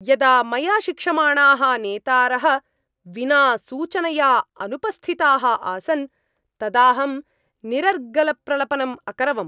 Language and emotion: Sanskrit, angry